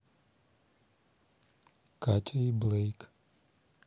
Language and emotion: Russian, neutral